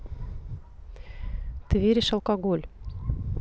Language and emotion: Russian, neutral